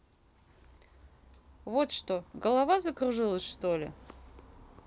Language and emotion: Russian, neutral